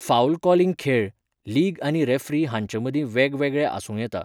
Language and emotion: Goan Konkani, neutral